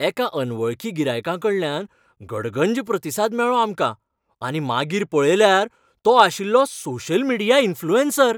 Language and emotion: Goan Konkani, happy